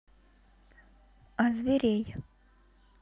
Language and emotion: Russian, neutral